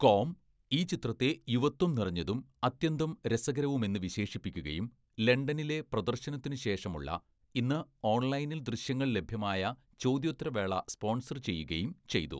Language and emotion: Malayalam, neutral